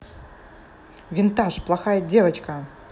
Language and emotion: Russian, angry